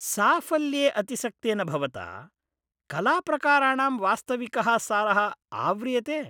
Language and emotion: Sanskrit, disgusted